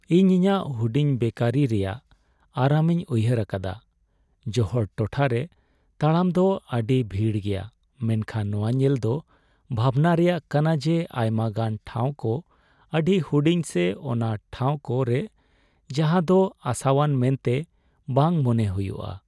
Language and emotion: Santali, sad